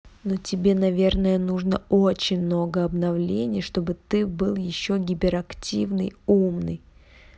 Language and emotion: Russian, angry